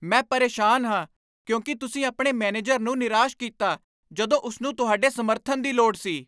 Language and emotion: Punjabi, angry